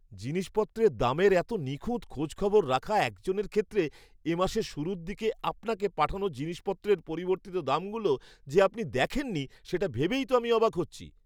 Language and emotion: Bengali, surprised